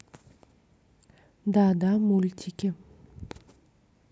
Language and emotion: Russian, neutral